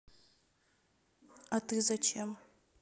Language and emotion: Russian, neutral